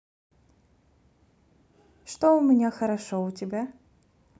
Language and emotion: Russian, neutral